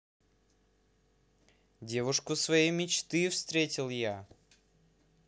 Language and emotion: Russian, positive